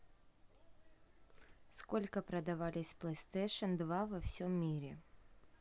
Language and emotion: Russian, neutral